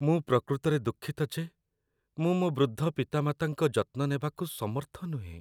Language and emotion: Odia, sad